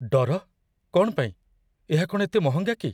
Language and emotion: Odia, fearful